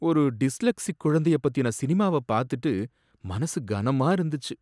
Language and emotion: Tamil, sad